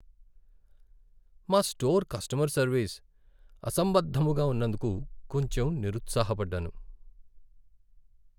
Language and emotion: Telugu, sad